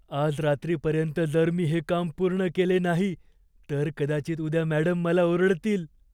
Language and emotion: Marathi, fearful